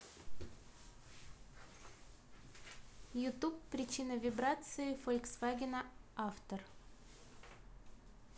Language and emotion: Russian, neutral